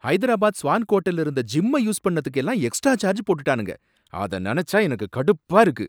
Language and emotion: Tamil, angry